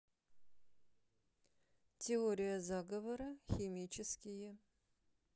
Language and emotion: Russian, neutral